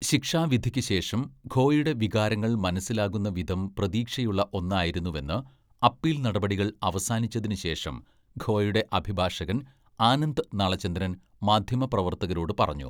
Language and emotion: Malayalam, neutral